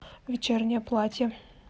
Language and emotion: Russian, neutral